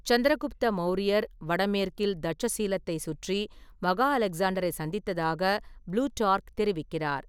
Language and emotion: Tamil, neutral